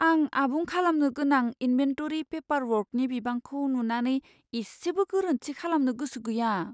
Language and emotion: Bodo, fearful